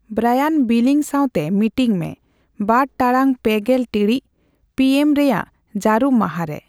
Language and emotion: Santali, neutral